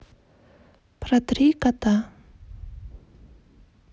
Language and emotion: Russian, neutral